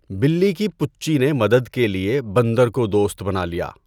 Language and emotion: Urdu, neutral